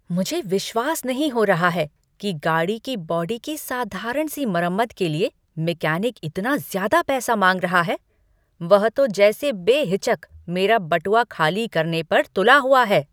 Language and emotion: Hindi, angry